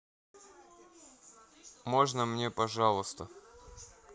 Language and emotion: Russian, neutral